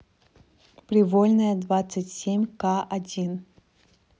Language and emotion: Russian, neutral